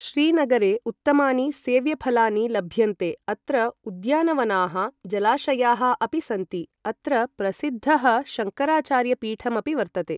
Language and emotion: Sanskrit, neutral